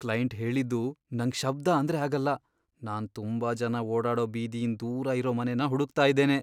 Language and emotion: Kannada, fearful